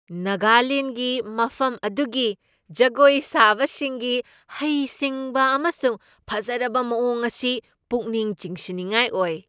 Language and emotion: Manipuri, surprised